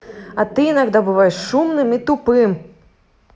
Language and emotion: Russian, angry